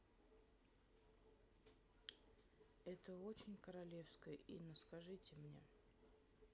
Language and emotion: Russian, neutral